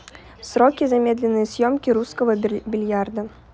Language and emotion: Russian, neutral